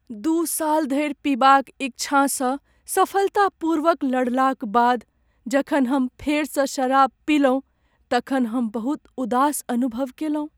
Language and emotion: Maithili, sad